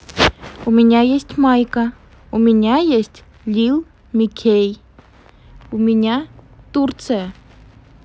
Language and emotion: Russian, neutral